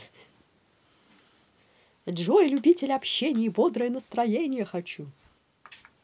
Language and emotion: Russian, positive